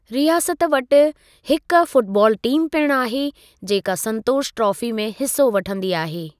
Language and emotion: Sindhi, neutral